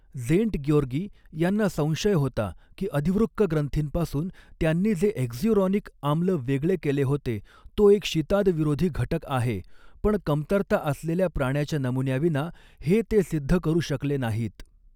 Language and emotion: Marathi, neutral